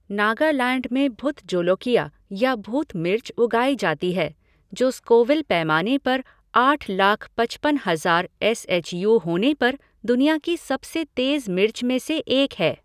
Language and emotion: Hindi, neutral